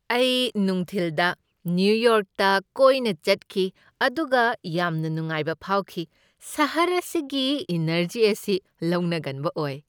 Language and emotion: Manipuri, happy